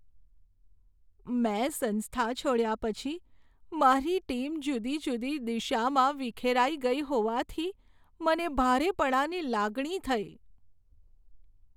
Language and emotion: Gujarati, sad